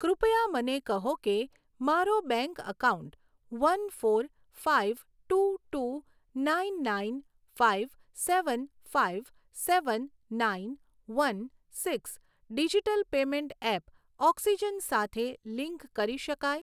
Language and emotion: Gujarati, neutral